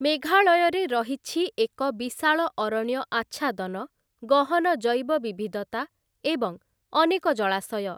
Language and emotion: Odia, neutral